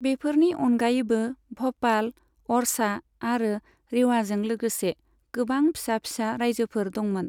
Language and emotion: Bodo, neutral